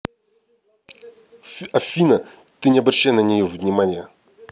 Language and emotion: Russian, neutral